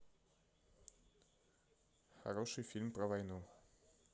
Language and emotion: Russian, neutral